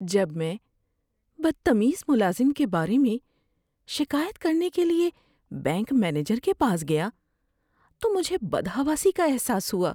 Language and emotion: Urdu, fearful